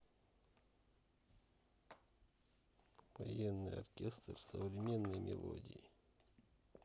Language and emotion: Russian, neutral